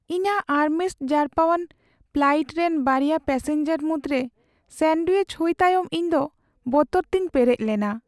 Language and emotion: Santali, sad